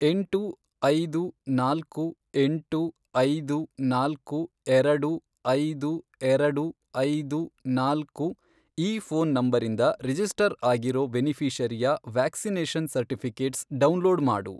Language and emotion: Kannada, neutral